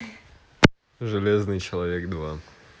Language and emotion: Russian, neutral